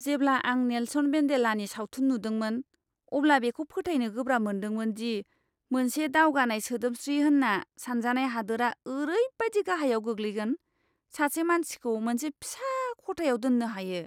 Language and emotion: Bodo, disgusted